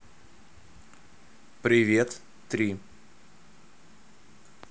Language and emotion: Russian, neutral